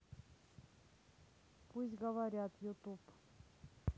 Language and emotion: Russian, neutral